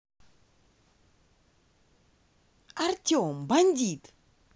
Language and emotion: Russian, positive